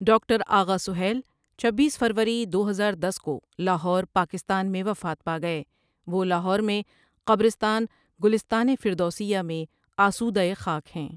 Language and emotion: Urdu, neutral